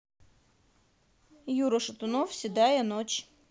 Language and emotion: Russian, neutral